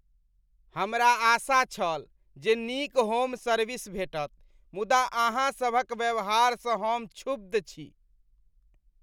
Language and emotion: Maithili, disgusted